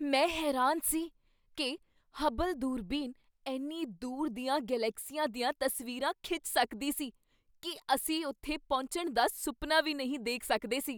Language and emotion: Punjabi, surprised